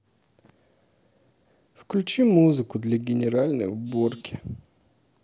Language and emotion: Russian, sad